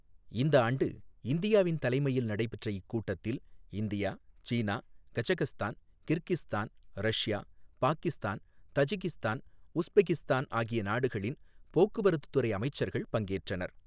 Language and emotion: Tamil, neutral